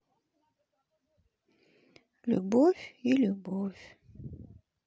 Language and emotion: Russian, sad